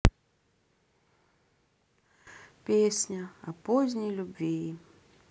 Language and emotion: Russian, sad